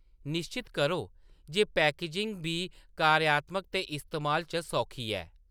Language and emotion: Dogri, neutral